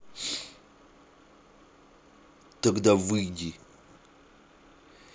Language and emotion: Russian, angry